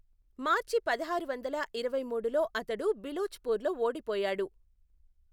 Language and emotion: Telugu, neutral